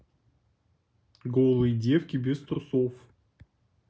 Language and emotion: Russian, neutral